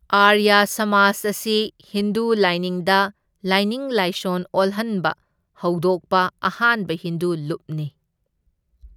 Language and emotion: Manipuri, neutral